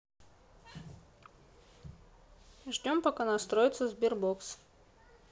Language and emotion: Russian, neutral